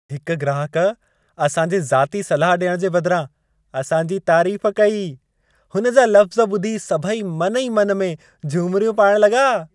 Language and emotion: Sindhi, happy